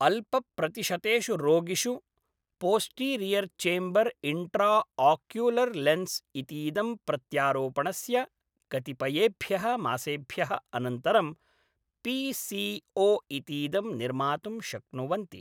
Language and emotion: Sanskrit, neutral